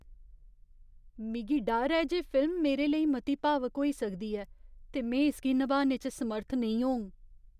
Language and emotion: Dogri, fearful